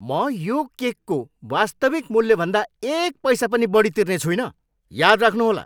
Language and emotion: Nepali, angry